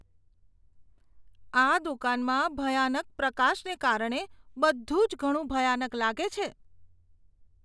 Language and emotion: Gujarati, disgusted